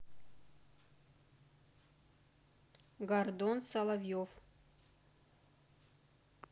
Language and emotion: Russian, neutral